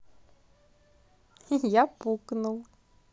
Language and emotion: Russian, positive